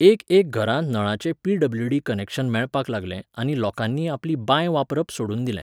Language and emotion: Goan Konkani, neutral